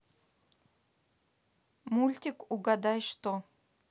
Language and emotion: Russian, neutral